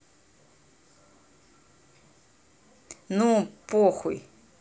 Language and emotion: Russian, angry